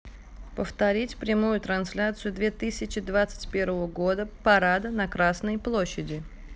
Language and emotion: Russian, neutral